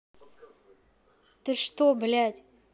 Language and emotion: Russian, angry